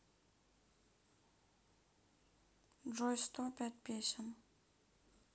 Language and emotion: Russian, sad